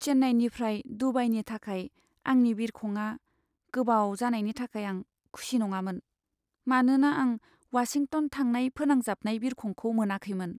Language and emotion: Bodo, sad